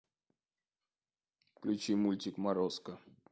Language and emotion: Russian, neutral